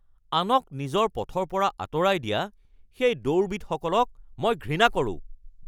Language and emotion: Assamese, angry